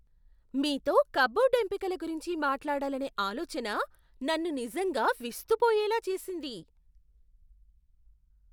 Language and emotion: Telugu, surprised